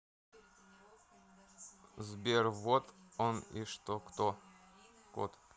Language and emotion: Russian, neutral